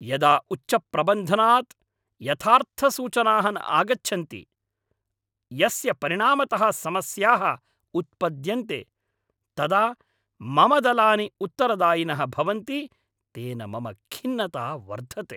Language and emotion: Sanskrit, angry